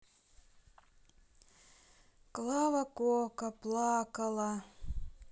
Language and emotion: Russian, sad